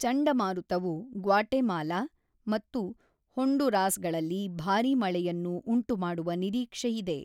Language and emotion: Kannada, neutral